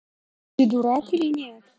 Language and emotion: Russian, neutral